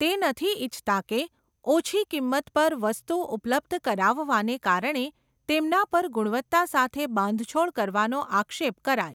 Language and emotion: Gujarati, neutral